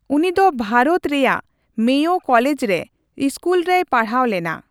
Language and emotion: Santali, neutral